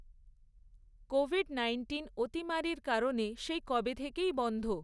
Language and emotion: Bengali, neutral